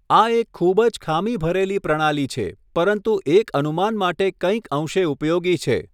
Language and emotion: Gujarati, neutral